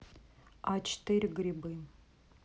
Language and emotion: Russian, neutral